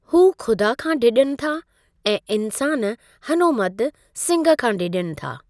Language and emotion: Sindhi, neutral